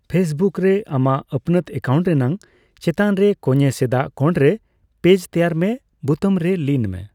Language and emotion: Santali, neutral